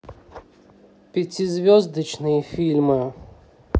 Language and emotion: Russian, neutral